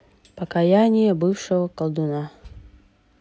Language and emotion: Russian, neutral